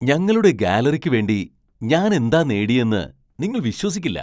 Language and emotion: Malayalam, surprised